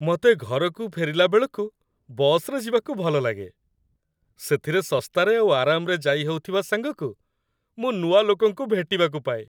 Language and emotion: Odia, happy